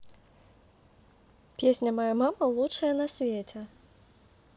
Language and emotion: Russian, positive